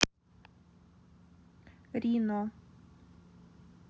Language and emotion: Russian, neutral